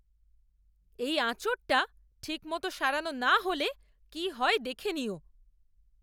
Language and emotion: Bengali, angry